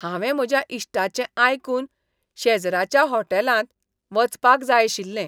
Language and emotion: Goan Konkani, disgusted